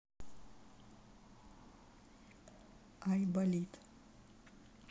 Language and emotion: Russian, neutral